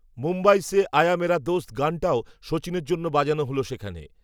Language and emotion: Bengali, neutral